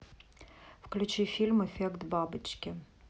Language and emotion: Russian, neutral